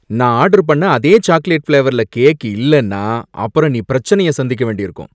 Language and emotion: Tamil, angry